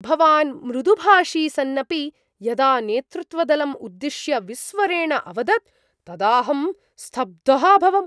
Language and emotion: Sanskrit, surprised